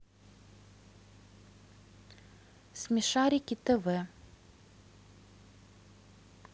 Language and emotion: Russian, neutral